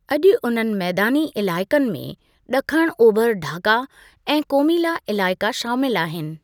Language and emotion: Sindhi, neutral